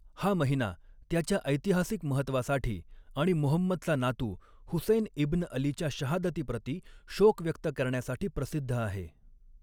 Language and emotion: Marathi, neutral